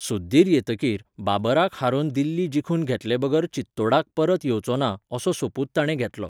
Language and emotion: Goan Konkani, neutral